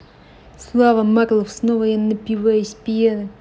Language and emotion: Russian, neutral